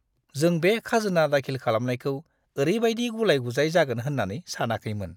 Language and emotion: Bodo, disgusted